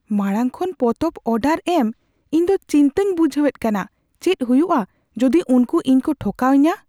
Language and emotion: Santali, fearful